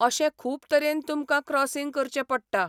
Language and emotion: Goan Konkani, neutral